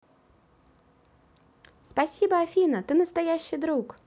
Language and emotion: Russian, positive